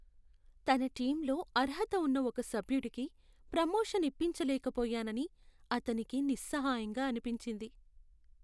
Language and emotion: Telugu, sad